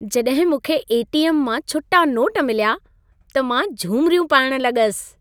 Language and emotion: Sindhi, happy